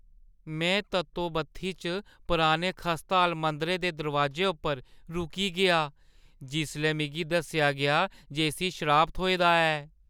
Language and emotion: Dogri, fearful